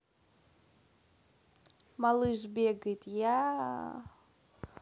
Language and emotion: Russian, neutral